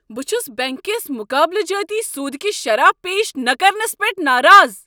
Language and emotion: Kashmiri, angry